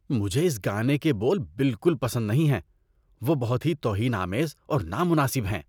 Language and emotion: Urdu, disgusted